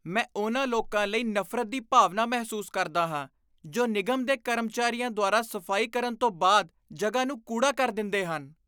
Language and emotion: Punjabi, disgusted